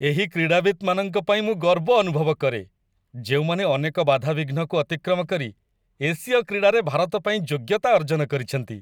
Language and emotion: Odia, happy